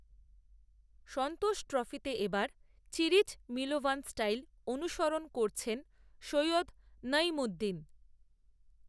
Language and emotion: Bengali, neutral